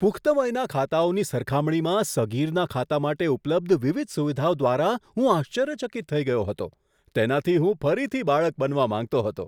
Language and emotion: Gujarati, surprised